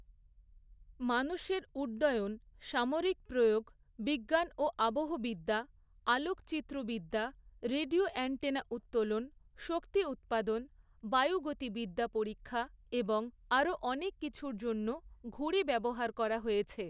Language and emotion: Bengali, neutral